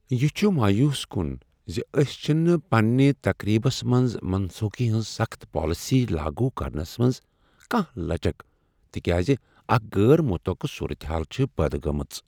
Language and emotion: Kashmiri, sad